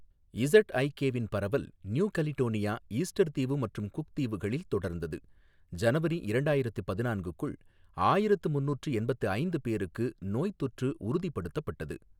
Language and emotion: Tamil, neutral